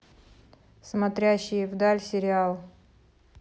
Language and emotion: Russian, neutral